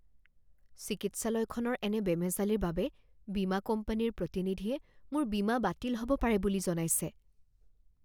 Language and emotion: Assamese, fearful